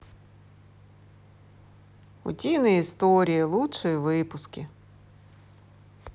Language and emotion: Russian, positive